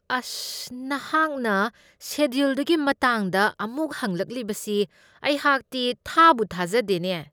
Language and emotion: Manipuri, disgusted